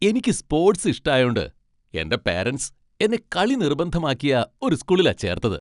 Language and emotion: Malayalam, happy